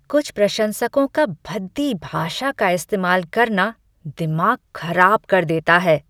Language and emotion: Hindi, disgusted